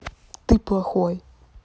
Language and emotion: Russian, angry